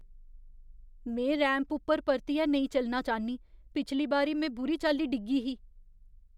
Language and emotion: Dogri, fearful